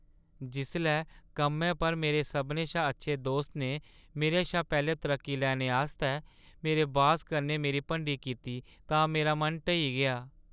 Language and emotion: Dogri, sad